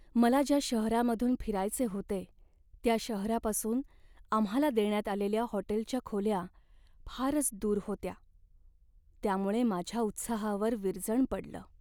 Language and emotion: Marathi, sad